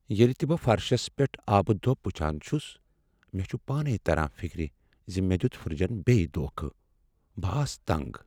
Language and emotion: Kashmiri, sad